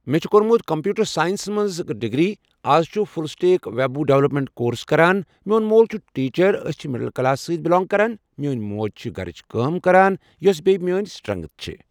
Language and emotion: Kashmiri, neutral